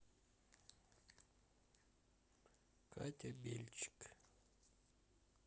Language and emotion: Russian, sad